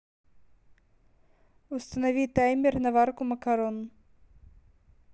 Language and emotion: Russian, neutral